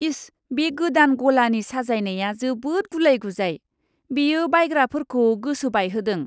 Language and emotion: Bodo, disgusted